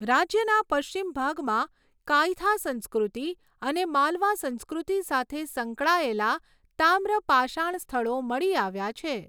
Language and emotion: Gujarati, neutral